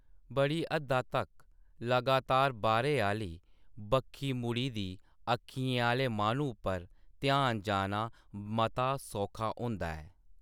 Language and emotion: Dogri, neutral